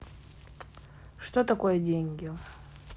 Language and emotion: Russian, neutral